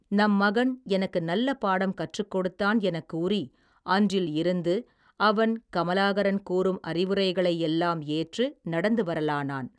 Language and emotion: Tamil, neutral